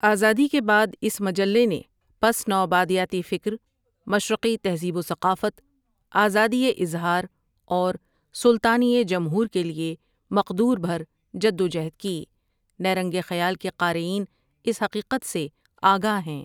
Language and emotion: Urdu, neutral